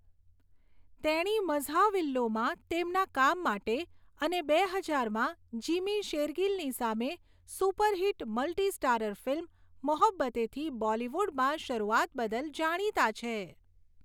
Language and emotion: Gujarati, neutral